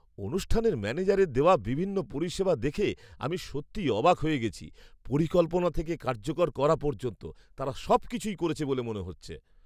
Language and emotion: Bengali, surprised